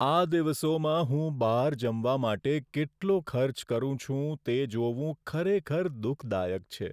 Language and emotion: Gujarati, sad